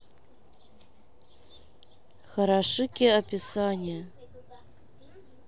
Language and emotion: Russian, neutral